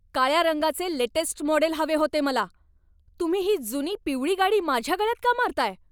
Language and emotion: Marathi, angry